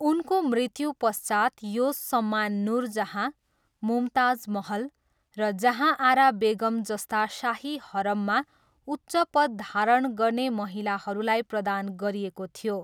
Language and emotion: Nepali, neutral